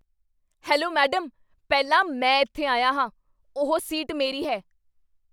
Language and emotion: Punjabi, angry